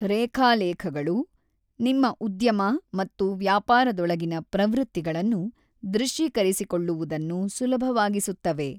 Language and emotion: Kannada, neutral